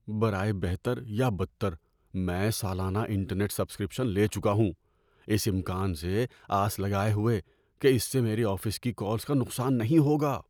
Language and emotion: Urdu, fearful